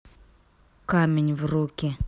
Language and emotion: Russian, angry